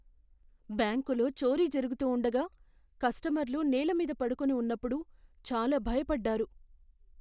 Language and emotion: Telugu, fearful